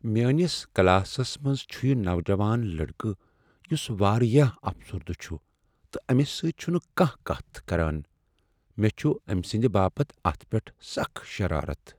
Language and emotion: Kashmiri, sad